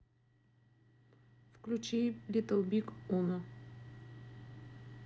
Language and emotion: Russian, neutral